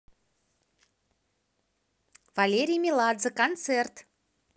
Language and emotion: Russian, positive